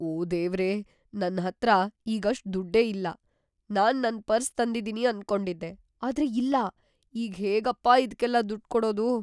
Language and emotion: Kannada, fearful